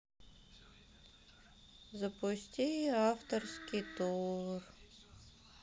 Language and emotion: Russian, sad